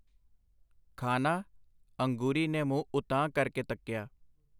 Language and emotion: Punjabi, neutral